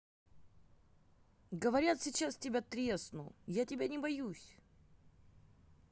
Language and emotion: Russian, neutral